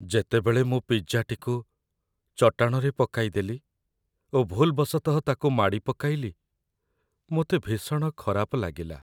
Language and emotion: Odia, sad